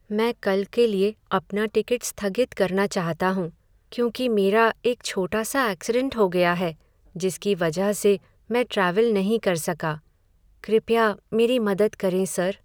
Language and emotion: Hindi, sad